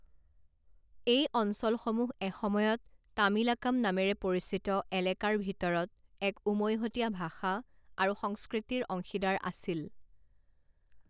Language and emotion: Assamese, neutral